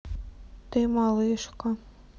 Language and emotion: Russian, sad